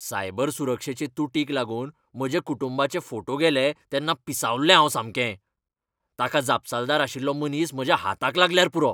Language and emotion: Goan Konkani, angry